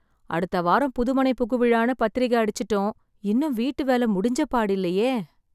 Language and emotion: Tamil, sad